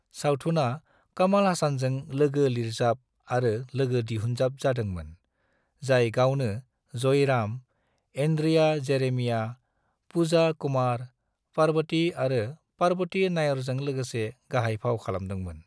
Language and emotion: Bodo, neutral